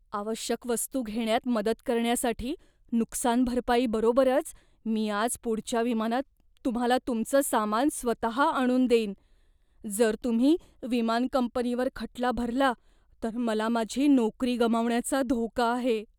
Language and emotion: Marathi, fearful